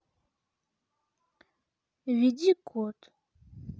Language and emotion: Russian, sad